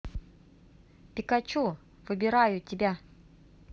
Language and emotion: Russian, positive